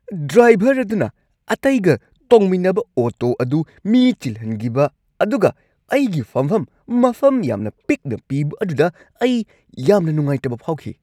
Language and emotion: Manipuri, angry